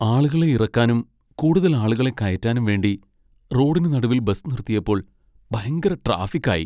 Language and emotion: Malayalam, sad